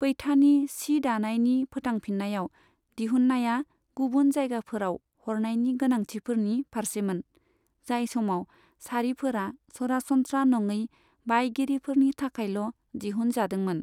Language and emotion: Bodo, neutral